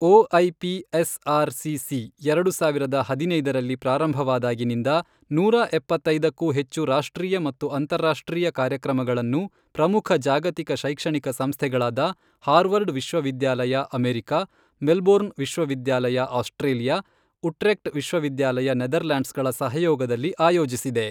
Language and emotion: Kannada, neutral